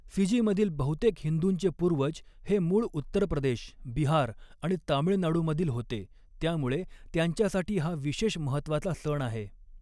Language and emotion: Marathi, neutral